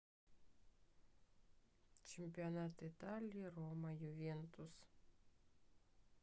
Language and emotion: Russian, neutral